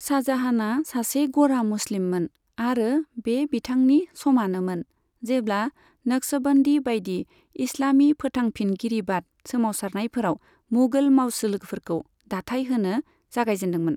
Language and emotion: Bodo, neutral